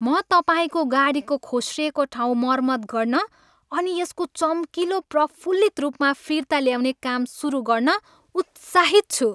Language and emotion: Nepali, happy